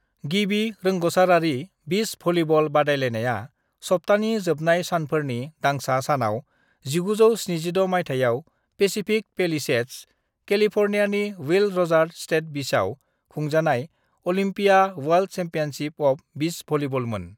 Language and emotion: Bodo, neutral